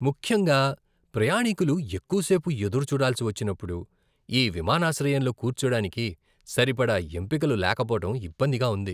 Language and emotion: Telugu, disgusted